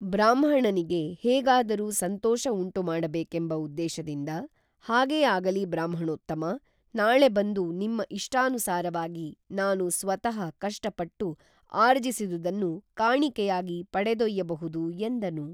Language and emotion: Kannada, neutral